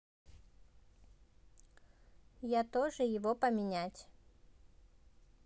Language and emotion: Russian, neutral